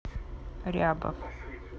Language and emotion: Russian, neutral